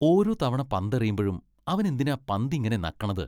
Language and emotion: Malayalam, disgusted